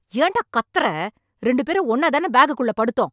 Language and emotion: Tamil, angry